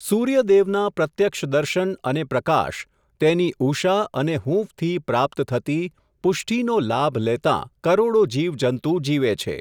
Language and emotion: Gujarati, neutral